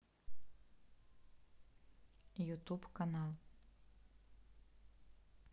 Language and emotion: Russian, neutral